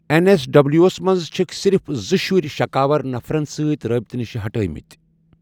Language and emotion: Kashmiri, neutral